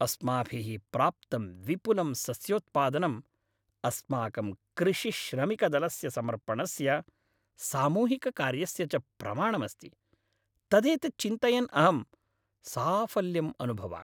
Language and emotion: Sanskrit, happy